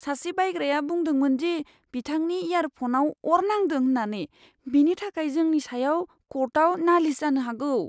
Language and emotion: Bodo, fearful